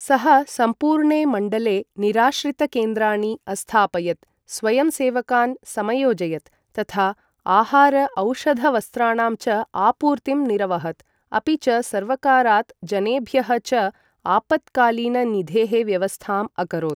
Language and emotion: Sanskrit, neutral